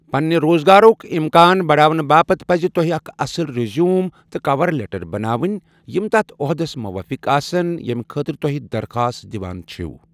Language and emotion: Kashmiri, neutral